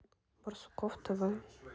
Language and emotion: Russian, neutral